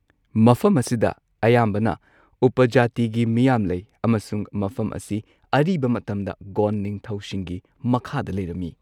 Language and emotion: Manipuri, neutral